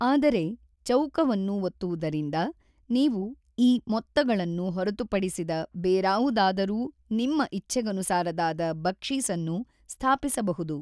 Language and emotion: Kannada, neutral